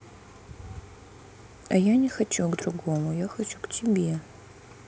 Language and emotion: Russian, sad